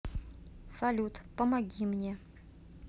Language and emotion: Russian, neutral